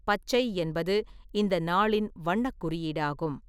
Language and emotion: Tamil, neutral